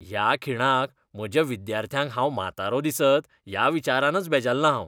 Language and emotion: Goan Konkani, disgusted